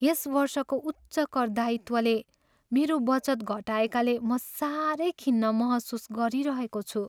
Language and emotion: Nepali, sad